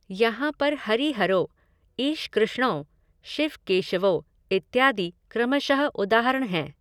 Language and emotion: Hindi, neutral